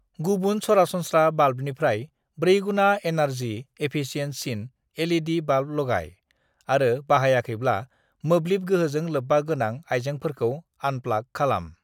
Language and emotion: Bodo, neutral